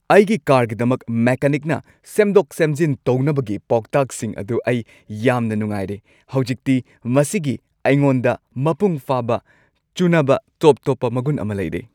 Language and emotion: Manipuri, happy